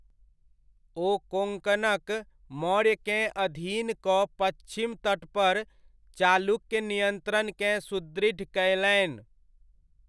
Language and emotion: Maithili, neutral